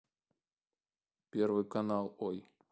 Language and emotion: Russian, neutral